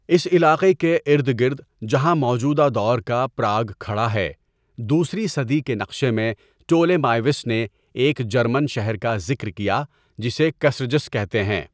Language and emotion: Urdu, neutral